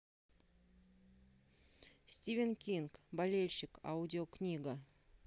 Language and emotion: Russian, neutral